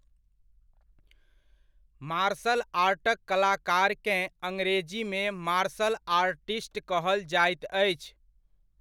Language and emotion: Maithili, neutral